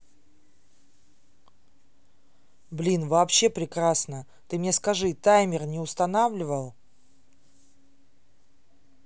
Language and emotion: Russian, neutral